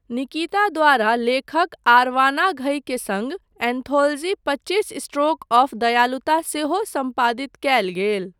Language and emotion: Maithili, neutral